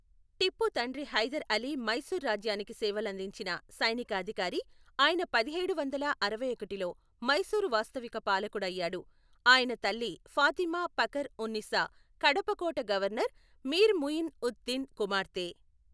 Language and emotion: Telugu, neutral